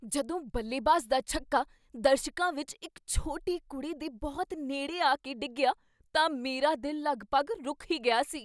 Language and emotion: Punjabi, surprised